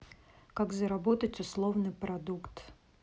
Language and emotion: Russian, neutral